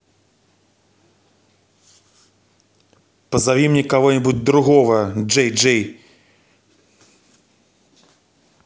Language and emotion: Russian, angry